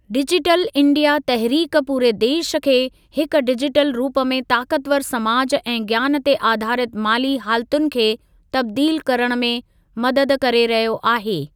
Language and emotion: Sindhi, neutral